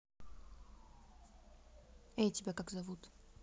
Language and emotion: Russian, neutral